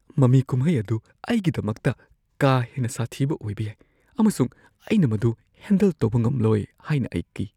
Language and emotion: Manipuri, fearful